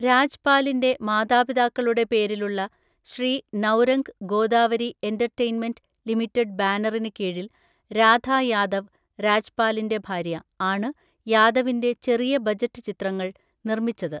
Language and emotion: Malayalam, neutral